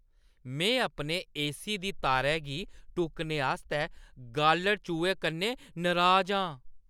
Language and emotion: Dogri, angry